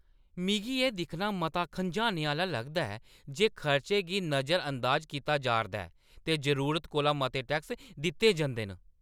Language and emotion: Dogri, angry